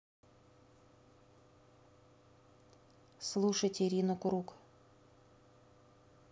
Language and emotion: Russian, neutral